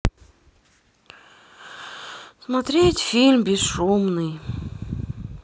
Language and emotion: Russian, sad